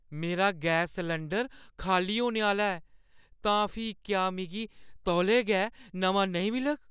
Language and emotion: Dogri, fearful